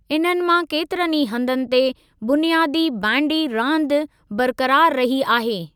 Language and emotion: Sindhi, neutral